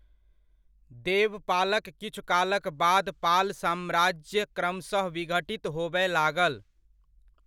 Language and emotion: Maithili, neutral